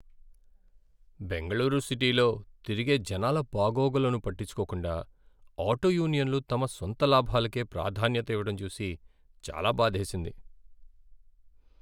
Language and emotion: Telugu, sad